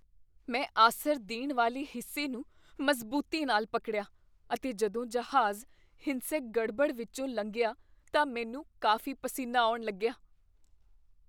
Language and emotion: Punjabi, fearful